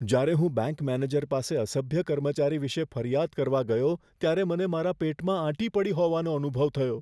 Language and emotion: Gujarati, fearful